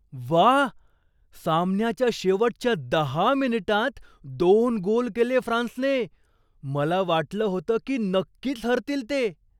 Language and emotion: Marathi, surprised